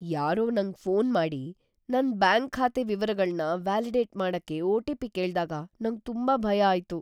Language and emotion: Kannada, fearful